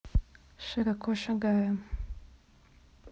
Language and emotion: Russian, neutral